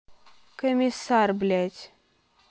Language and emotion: Russian, angry